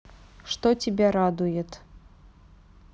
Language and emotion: Russian, neutral